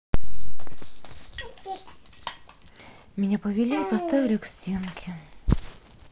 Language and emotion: Russian, sad